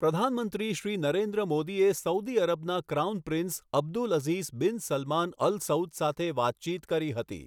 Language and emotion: Gujarati, neutral